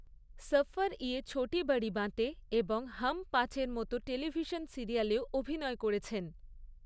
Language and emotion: Bengali, neutral